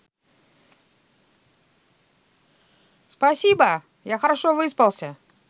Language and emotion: Russian, positive